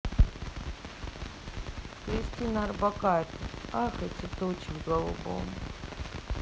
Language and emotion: Russian, sad